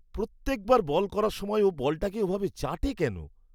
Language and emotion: Bengali, disgusted